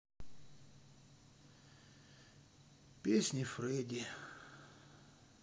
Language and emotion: Russian, sad